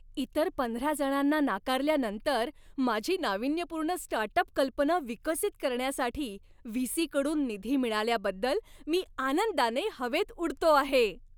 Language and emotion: Marathi, happy